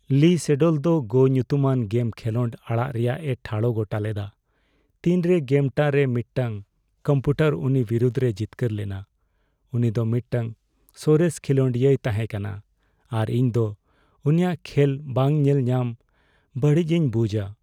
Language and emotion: Santali, sad